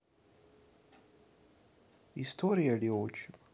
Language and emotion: Russian, neutral